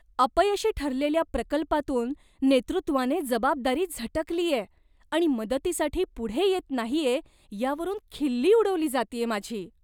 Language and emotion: Marathi, disgusted